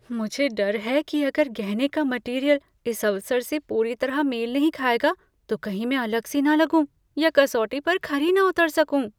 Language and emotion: Hindi, fearful